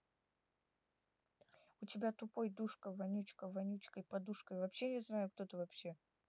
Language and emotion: Russian, neutral